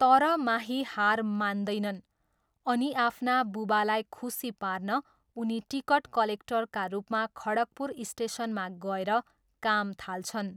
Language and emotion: Nepali, neutral